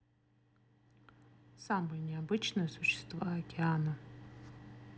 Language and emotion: Russian, neutral